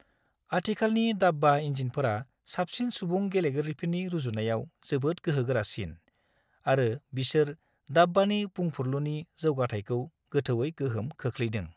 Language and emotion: Bodo, neutral